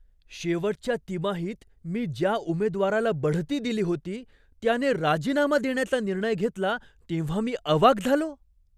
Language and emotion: Marathi, surprised